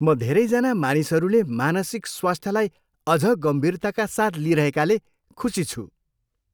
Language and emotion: Nepali, happy